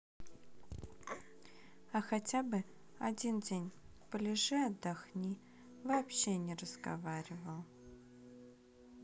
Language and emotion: Russian, neutral